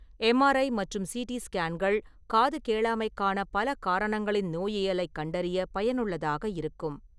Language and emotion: Tamil, neutral